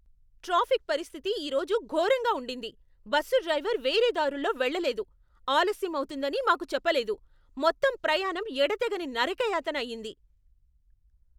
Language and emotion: Telugu, angry